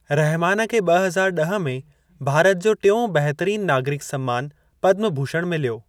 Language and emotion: Sindhi, neutral